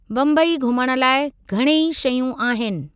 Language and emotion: Sindhi, neutral